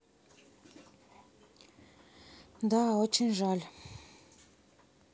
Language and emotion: Russian, sad